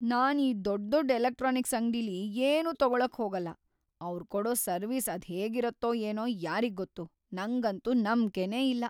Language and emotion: Kannada, fearful